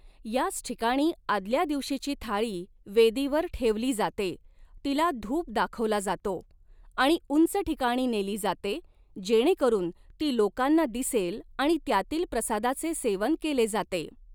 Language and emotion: Marathi, neutral